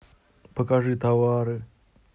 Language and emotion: Russian, sad